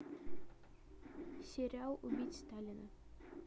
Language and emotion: Russian, neutral